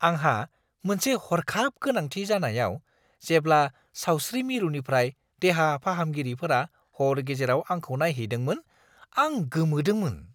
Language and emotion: Bodo, surprised